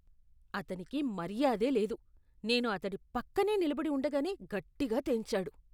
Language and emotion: Telugu, disgusted